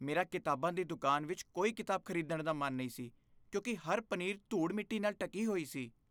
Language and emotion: Punjabi, disgusted